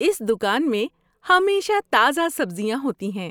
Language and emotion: Urdu, happy